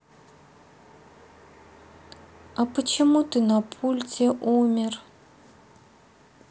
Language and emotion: Russian, sad